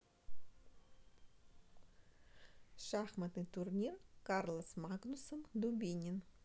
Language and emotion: Russian, neutral